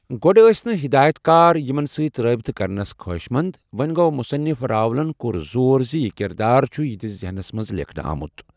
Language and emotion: Kashmiri, neutral